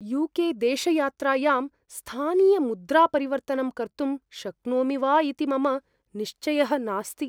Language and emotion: Sanskrit, fearful